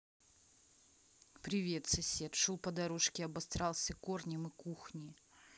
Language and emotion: Russian, neutral